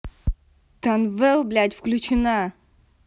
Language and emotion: Russian, angry